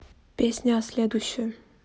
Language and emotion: Russian, neutral